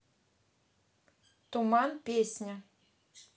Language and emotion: Russian, neutral